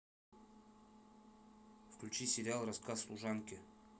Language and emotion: Russian, neutral